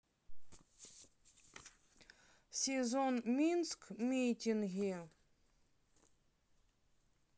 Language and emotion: Russian, neutral